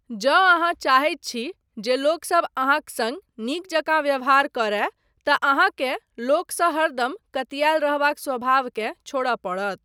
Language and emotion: Maithili, neutral